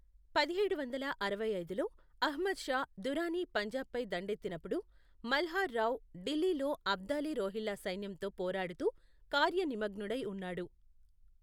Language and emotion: Telugu, neutral